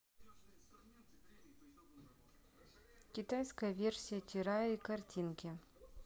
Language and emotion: Russian, neutral